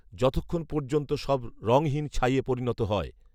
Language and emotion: Bengali, neutral